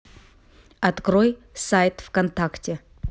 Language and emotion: Russian, neutral